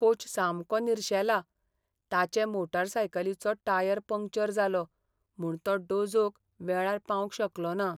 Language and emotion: Goan Konkani, sad